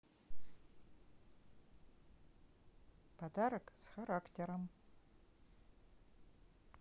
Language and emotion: Russian, neutral